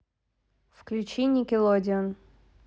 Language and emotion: Russian, neutral